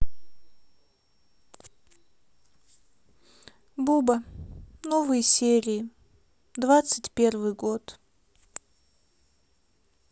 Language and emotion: Russian, sad